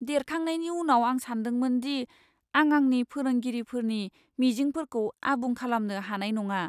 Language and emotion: Bodo, fearful